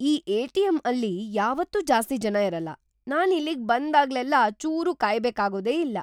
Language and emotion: Kannada, surprised